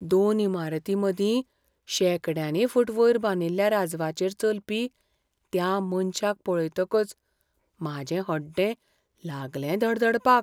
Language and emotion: Goan Konkani, fearful